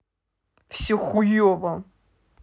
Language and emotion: Russian, sad